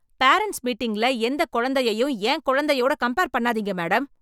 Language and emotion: Tamil, angry